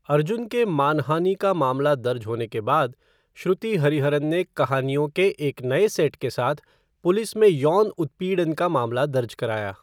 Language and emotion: Hindi, neutral